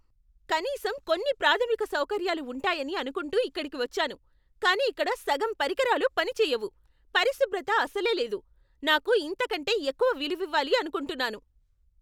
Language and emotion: Telugu, angry